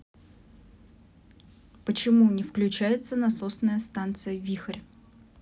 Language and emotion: Russian, neutral